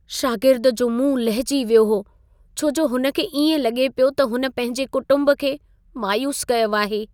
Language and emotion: Sindhi, sad